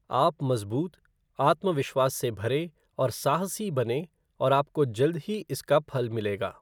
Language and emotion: Hindi, neutral